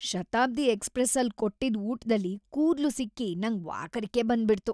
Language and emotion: Kannada, disgusted